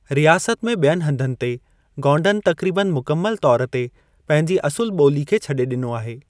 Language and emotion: Sindhi, neutral